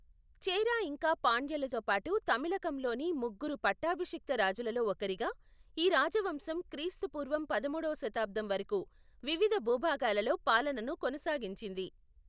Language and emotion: Telugu, neutral